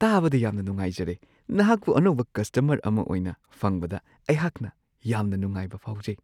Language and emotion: Manipuri, surprised